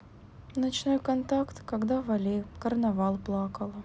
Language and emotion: Russian, sad